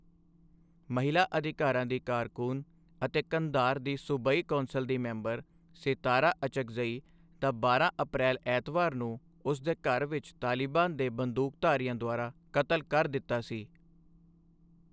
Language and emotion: Punjabi, neutral